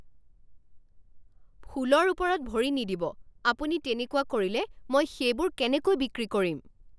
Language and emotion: Assamese, angry